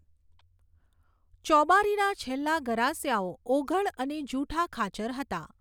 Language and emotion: Gujarati, neutral